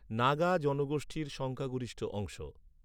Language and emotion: Bengali, neutral